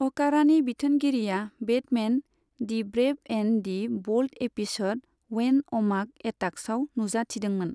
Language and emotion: Bodo, neutral